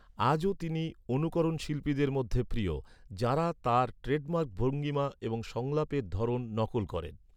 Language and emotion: Bengali, neutral